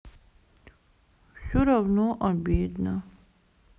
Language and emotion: Russian, sad